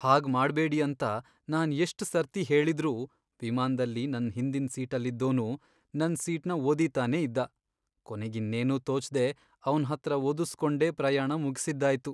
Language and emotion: Kannada, sad